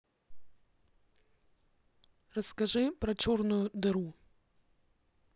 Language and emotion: Russian, neutral